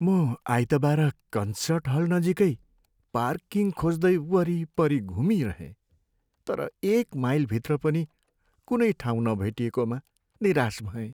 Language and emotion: Nepali, sad